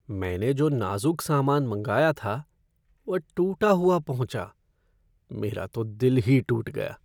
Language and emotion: Hindi, sad